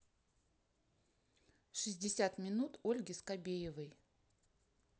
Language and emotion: Russian, neutral